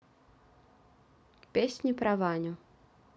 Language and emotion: Russian, neutral